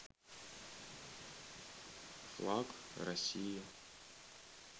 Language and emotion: Russian, neutral